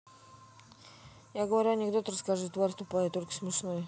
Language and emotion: Russian, neutral